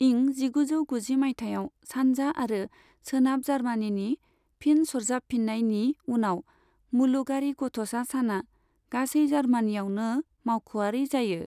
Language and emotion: Bodo, neutral